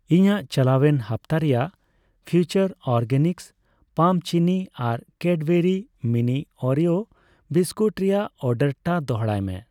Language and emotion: Santali, neutral